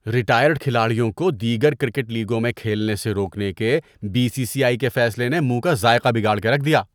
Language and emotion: Urdu, disgusted